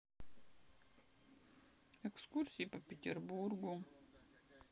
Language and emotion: Russian, sad